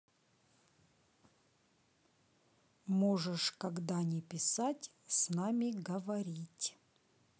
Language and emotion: Russian, neutral